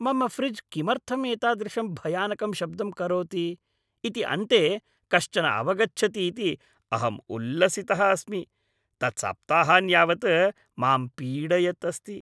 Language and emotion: Sanskrit, happy